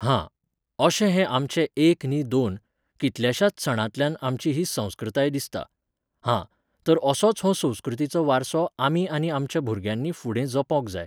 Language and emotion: Goan Konkani, neutral